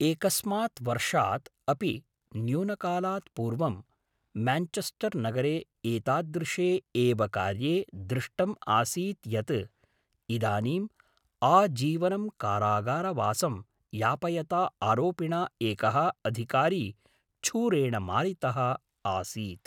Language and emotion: Sanskrit, neutral